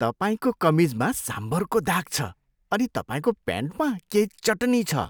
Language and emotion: Nepali, disgusted